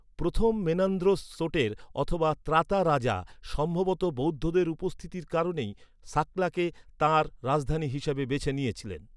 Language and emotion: Bengali, neutral